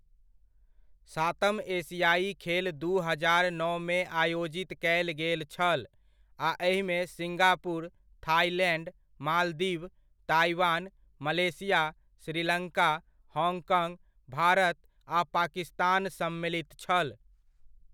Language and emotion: Maithili, neutral